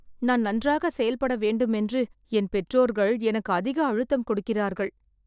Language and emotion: Tamil, sad